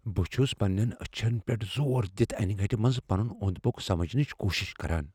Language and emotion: Kashmiri, fearful